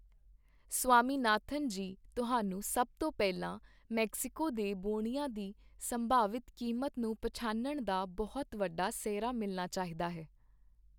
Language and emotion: Punjabi, neutral